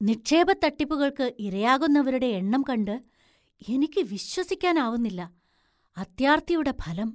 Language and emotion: Malayalam, surprised